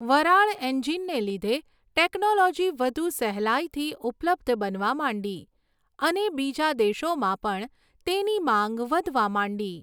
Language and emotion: Gujarati, neutral